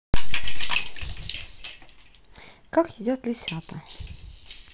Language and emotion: Russian, neutral